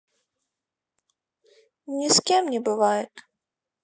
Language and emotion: Russian, sad